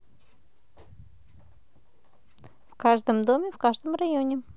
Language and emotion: Russian, positive